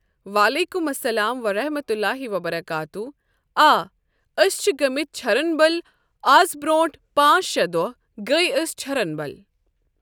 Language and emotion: Kashmiri, neutral